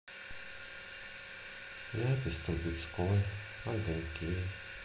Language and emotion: Russian, sad